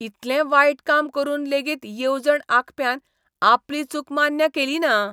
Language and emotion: Goan Konkani, disgusted